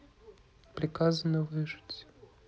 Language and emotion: Russian, neutral